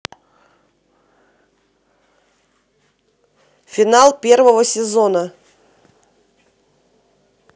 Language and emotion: Russian, neutral